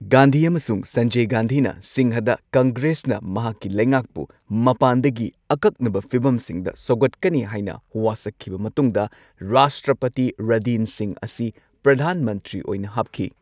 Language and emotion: Manipuri, neutral